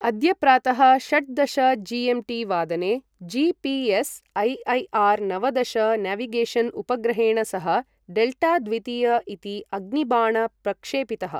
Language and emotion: Sanskrit, neutral